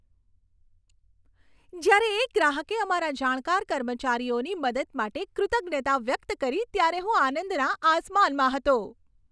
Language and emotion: Gujarati, happy